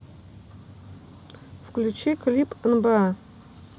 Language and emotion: Russian, neutral